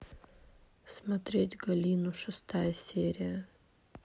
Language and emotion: Russian, sad